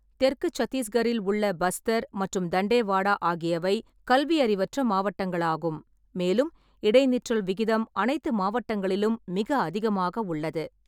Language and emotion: Tamil, neutral